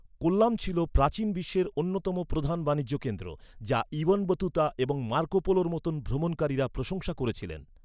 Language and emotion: Bengali, neutral